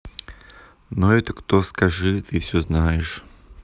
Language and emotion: Russian, neutral